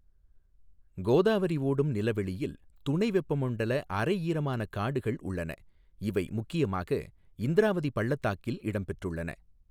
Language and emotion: Tamil, neutral